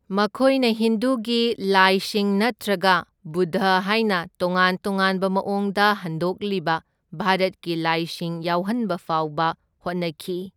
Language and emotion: Manipuri, neutral